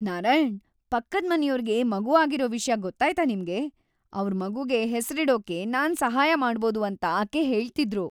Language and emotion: Kannada, happy